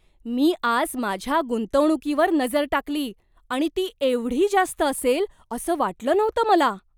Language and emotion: Marathi, surprised